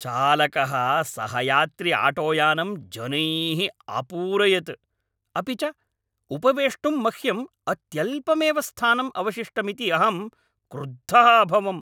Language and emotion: Sanskrit, angry